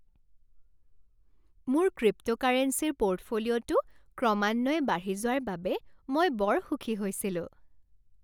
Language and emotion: Assamese, happy